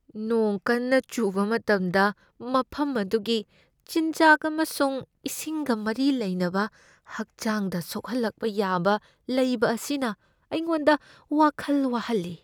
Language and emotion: Manipuri, fearful